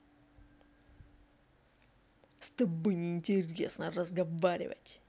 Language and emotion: Russian, angry